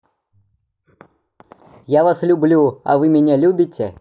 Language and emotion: Russian, positive